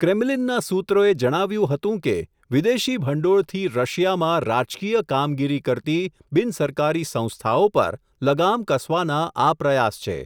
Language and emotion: Gujarati, neutral